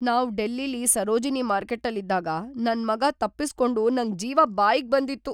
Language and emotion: Kannada, fearful